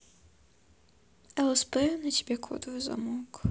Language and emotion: Russian, sad